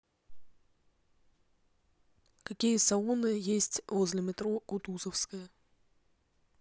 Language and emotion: Russian, neutral